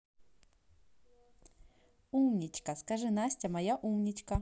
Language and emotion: Russian, positive